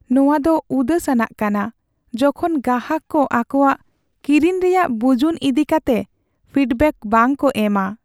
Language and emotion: Santali, sad